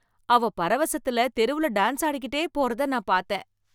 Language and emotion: Tamil, happy